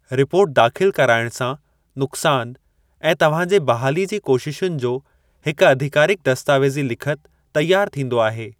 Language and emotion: Sindhi, neutral